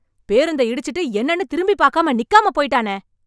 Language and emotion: Tamil, angry